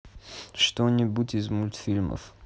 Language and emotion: Russian, neutral